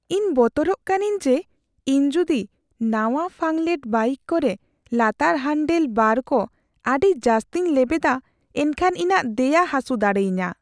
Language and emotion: Santali, fearful